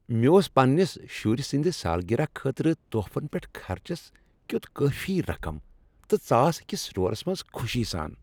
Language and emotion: Kashmiri, happy